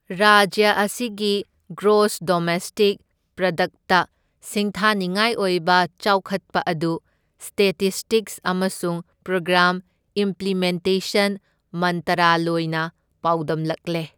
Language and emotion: Manipuri, neutral